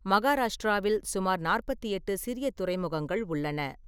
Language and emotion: Tamil, neutral